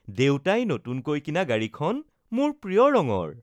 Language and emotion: Assamese, happy